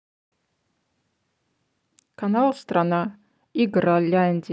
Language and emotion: Russian, neutral